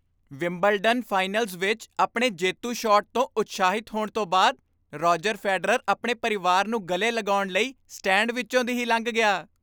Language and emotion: Punjabi, happy